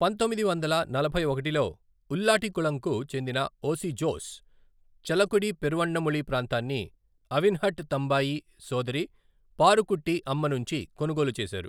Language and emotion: Telugu, neutral